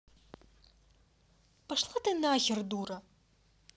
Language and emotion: Russian, angry